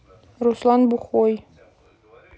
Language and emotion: Russian, neutral